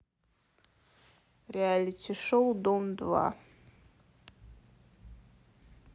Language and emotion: Russian, neutral